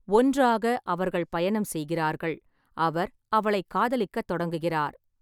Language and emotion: Tamil, neutral